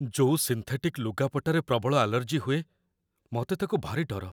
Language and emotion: Odia, fearful